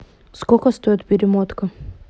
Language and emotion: Russian, neutral